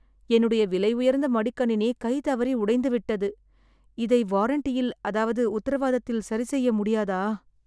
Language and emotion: Tamil, sad